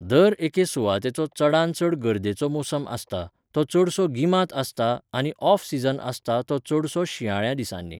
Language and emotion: Goan Konkani, neutral